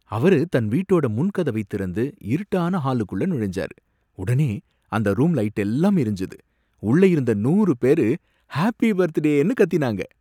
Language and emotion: Tamil, surprised